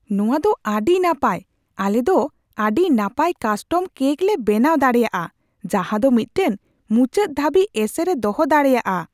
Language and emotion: Santali, surprised